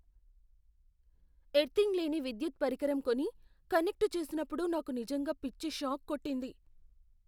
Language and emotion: Telugu, fearful